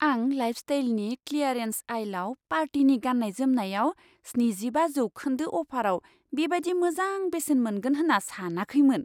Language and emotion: Bodo, surprised